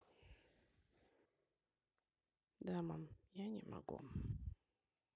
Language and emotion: Russian, neutral